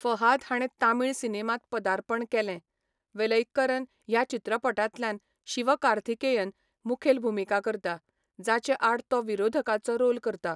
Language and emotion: Goan Konkani, neutral